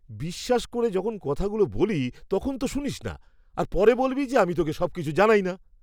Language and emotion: Bengali, disgusted